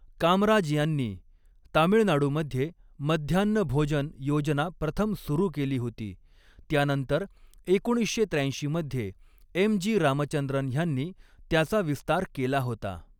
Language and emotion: Marathi, neutral